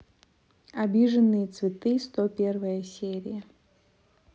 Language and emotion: Russian, neutral